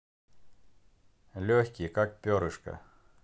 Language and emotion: Russian, neutral